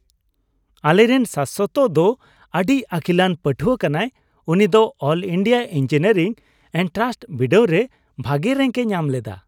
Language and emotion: Santali, happy